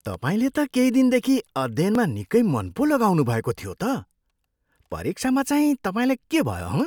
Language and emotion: Nepali, surprised